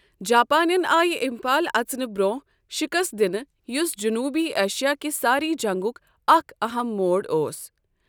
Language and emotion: Kashmiri, neutral